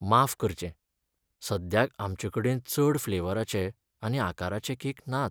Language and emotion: Goan Konkani, sad